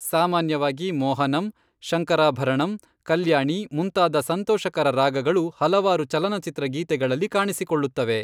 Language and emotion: Kannada, neutral